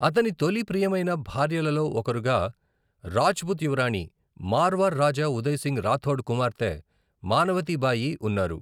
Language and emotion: Telugu, neutral